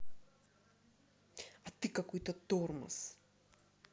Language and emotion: Russian, angry